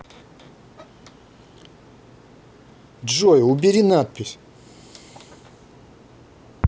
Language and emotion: Russian, angry